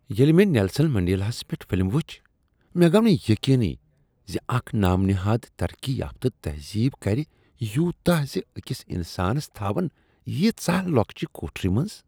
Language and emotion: Kashmiri, disgusted